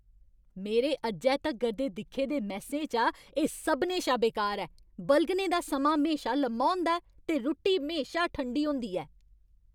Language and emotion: Dogri, angry